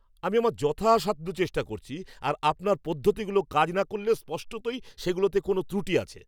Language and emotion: Bengali, angry